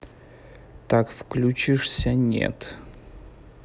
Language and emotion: Russian, neutral